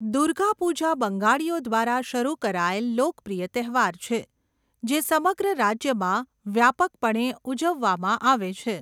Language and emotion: Gujarati, neutral